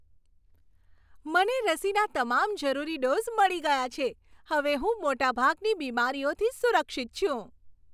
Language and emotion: Gujarati, happy